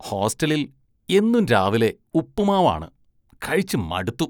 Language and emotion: Malayalam, disgusted